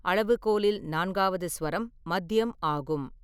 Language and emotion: Tamil, neutral